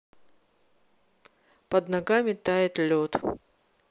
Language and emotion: Russian, neutral